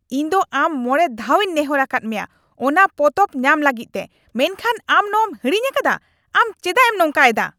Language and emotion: Santali, angry